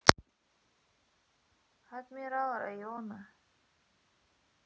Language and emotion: Russian, sad